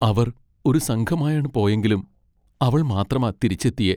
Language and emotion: Malayalam, sad